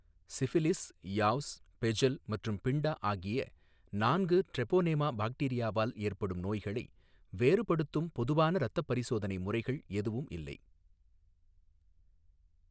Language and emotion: Tamil, neutral